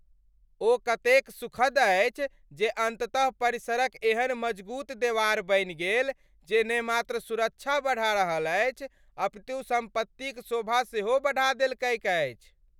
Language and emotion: Maithili, happy